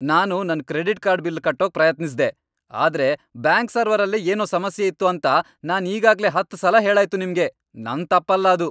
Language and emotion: Kannada, angry